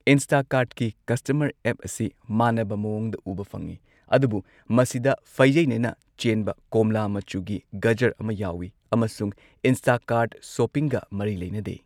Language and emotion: Manipuri, neutral